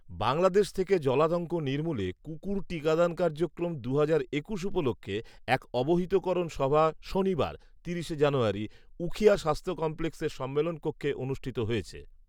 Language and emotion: Bengali, neutral